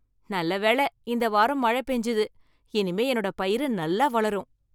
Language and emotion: Tamil, happy